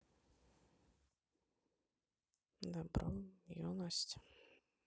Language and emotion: Russian, sad